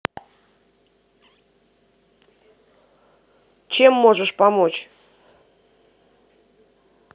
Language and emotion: Russian, angry